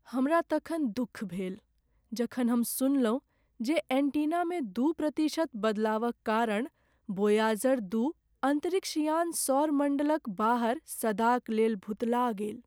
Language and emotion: Maithili, sad